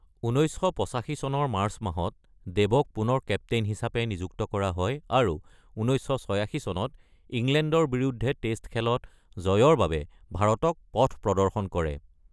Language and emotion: Assamese, neutral